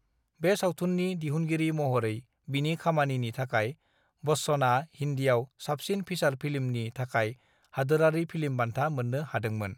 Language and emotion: Bodo, neutral